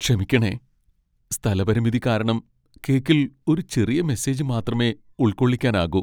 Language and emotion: Malayalam, sad